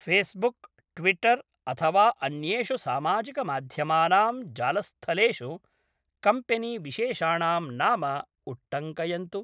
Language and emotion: Sanskrit, neutral